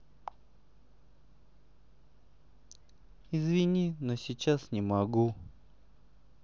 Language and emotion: Russian, sad